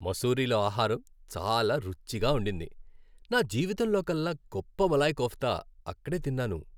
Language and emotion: Telugu, happy